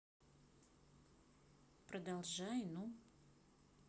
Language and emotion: Russian, neutral